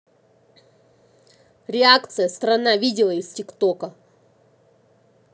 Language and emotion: Russian, angry